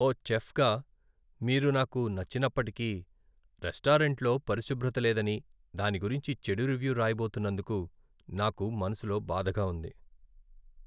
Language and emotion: Telugu, sad